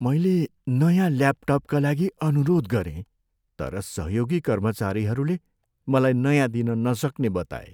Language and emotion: Nepali, sad